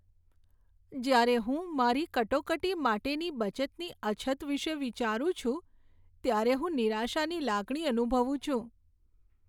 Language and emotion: Gujarati, sad